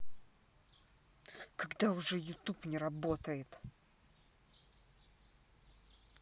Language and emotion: Russian, angry